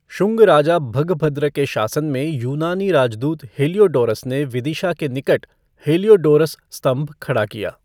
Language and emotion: Hindi, neutral